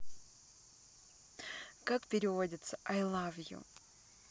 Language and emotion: Russian, neutral